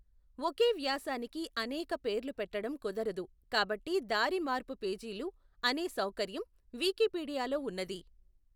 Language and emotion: Telugu, neutral